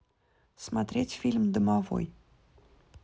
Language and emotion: Russian, neutral